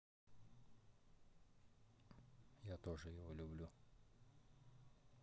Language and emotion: Russian, neutral